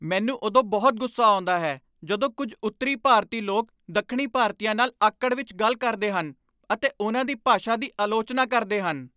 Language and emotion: Punjabi, angry